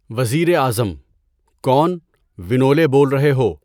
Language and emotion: Urdu, neutral